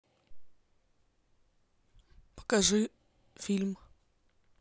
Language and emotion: Russian, neutral